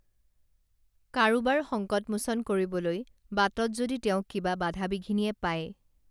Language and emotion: Assamese, neutral